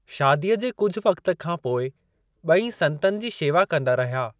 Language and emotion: Sindhi, neutral